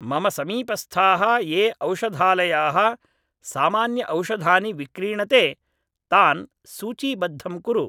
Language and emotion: Sanskrit, neutral